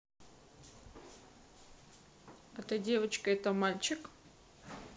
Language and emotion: Russian, neutral